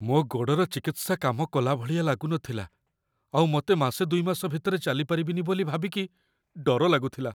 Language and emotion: Odia, fearful